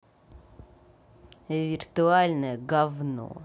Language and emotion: Russian, angry